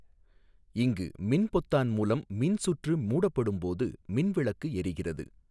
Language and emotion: Tamil, neutral